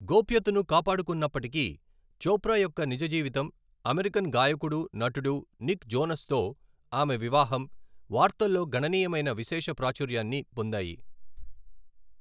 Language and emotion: Telugu, neutral